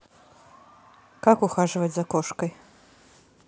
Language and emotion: Russian, neutral